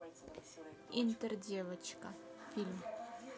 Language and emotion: Russian, neutral